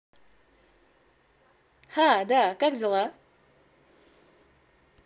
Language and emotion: Russian, positive